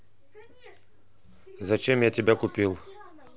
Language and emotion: Russian, neutral